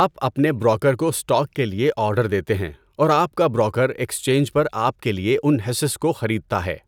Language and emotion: Urdu, neutral